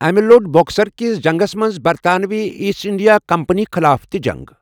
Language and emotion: Kashmiri, neutral